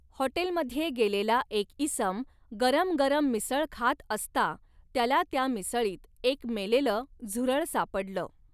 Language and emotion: Marathi, neutral